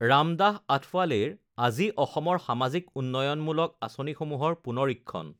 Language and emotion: Assamese, neutral